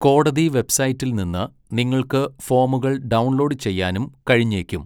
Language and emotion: Malayalam, neutral